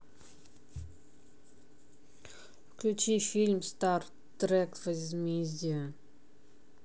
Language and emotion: Russian, neutral